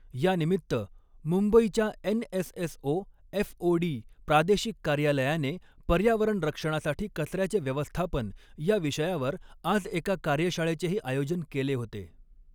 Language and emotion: Marathi, neutral